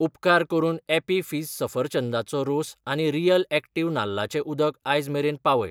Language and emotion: Goan Konkani, neutral